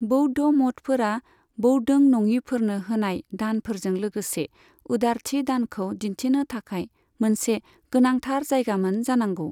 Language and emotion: Bodo, neutral